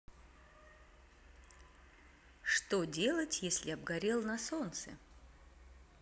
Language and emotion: Russian, neutral